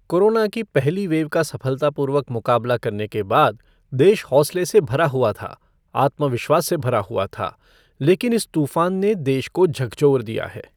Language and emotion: Hindi, neutral